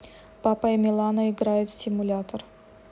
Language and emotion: Russian, neutral